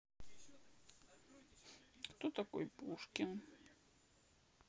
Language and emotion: Russian, sad